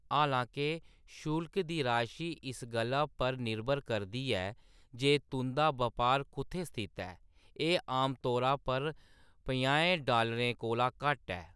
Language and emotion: Dogri, neutral